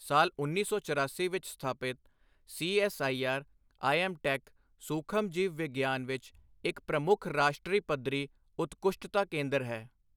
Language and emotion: Punjabi, neutral